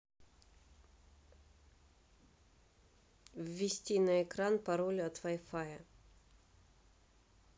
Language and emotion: Russian, neutral